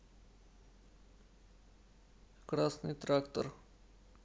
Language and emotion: Russian, neutral